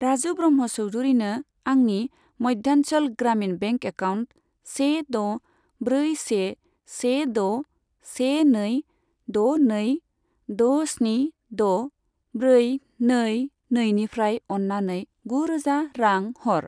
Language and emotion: Bodo, neutral